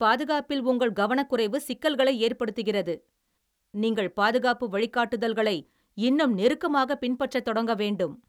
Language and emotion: Tamil, angry